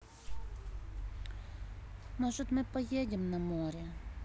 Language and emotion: Russian, sad